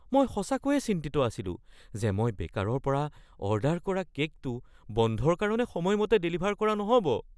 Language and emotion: Assamese, fearful